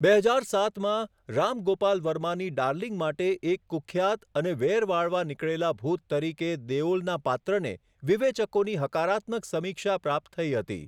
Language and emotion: Gujarati, neutral